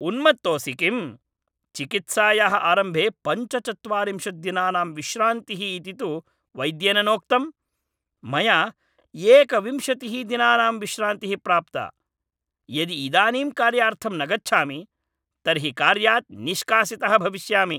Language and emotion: Sanskrit, angry